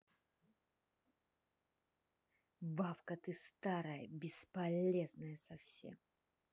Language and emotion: Russian, angry